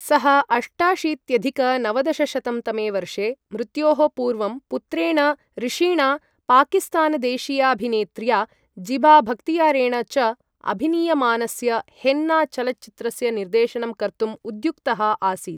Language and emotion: Sanskrit, neutral